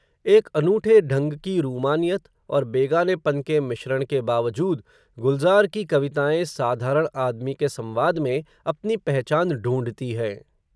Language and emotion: Hindi, neutral